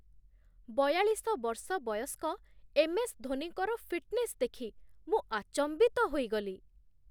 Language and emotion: Odia, surprised